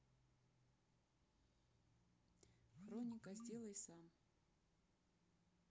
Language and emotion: Russian, neutral